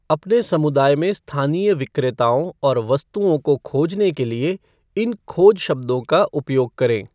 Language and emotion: Hindi, neutral